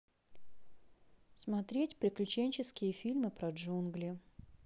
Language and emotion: Russian, neutral